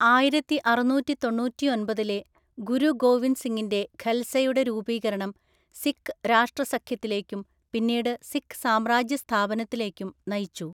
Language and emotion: Malayalam, neutral